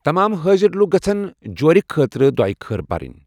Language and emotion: Kashmiri, neutral